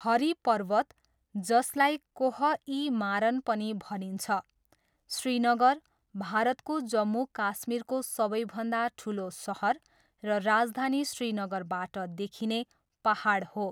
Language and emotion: Nepali, neutral